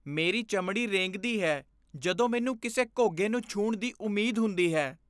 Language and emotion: Punjabi, disgusted